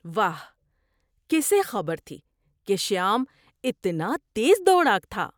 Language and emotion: Urdu, surprised